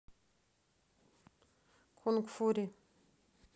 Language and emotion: Russian, neutral